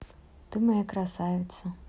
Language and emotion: Russian, positive